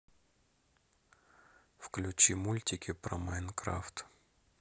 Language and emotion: Russian, neutral